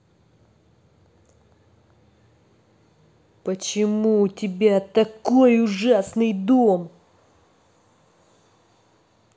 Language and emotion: Russian, angry